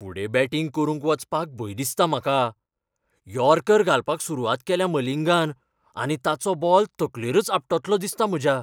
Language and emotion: Goan Konkani, fearful